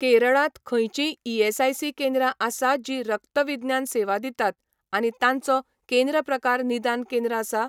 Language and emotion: Goan Konkani, neutral